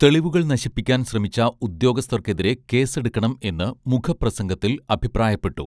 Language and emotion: Malayalam, neutral